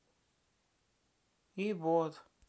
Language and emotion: Russian, sad